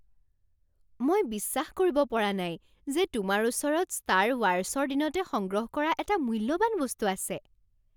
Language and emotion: Assamese, surprised